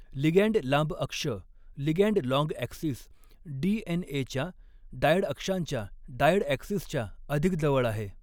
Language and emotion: Marathi, neutral